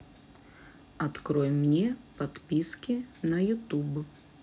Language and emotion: Russian, neutral